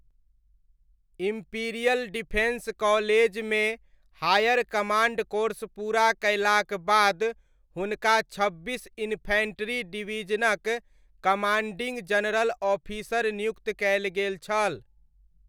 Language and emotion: Maithili, neutral